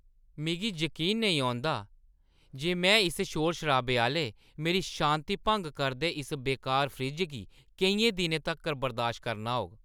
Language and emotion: Dogri, angry